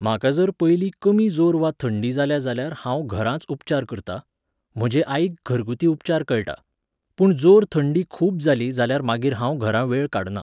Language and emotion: Goan Konkani, neutral